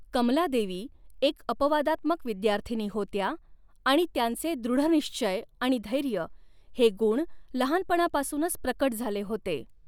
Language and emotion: Marathi, neutral